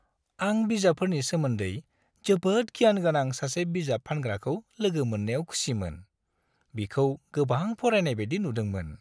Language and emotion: Bodo, happy